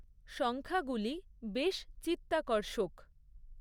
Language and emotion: Bengali, neutral